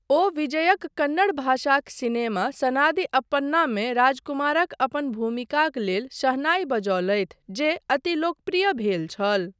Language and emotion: Maithili, neutral